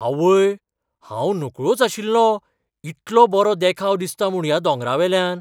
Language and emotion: Goan Konkani, surprised